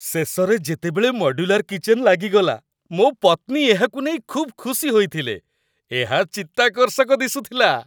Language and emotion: Odia, happy